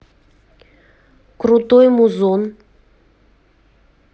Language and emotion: Russian, neutral